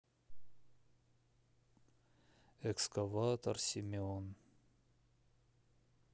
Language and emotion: Russian, sad